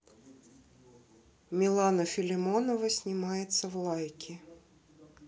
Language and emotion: Russian, neutral